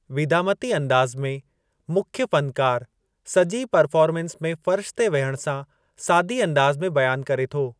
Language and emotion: Sindhi, neutral